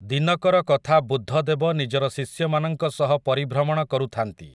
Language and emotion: Odia, neutral